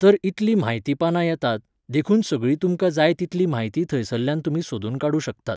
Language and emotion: Goan Konkani, neutral